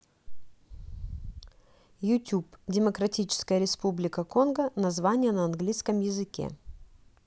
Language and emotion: Russian, neutral